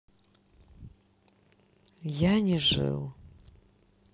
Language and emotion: Russian, sad